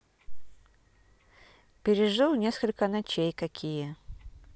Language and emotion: Russian, neutral